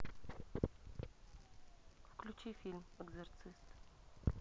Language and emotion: Russian, neutral